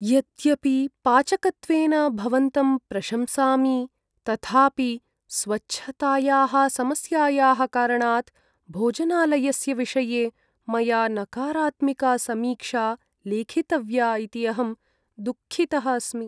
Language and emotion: Sanskrit, sad